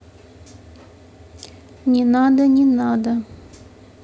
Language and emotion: Russian, neutral